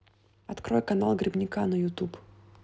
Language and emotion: Russian, neutral